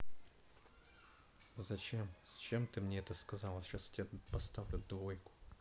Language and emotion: Russian, angry